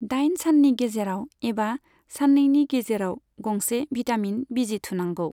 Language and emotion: Bodo, neutral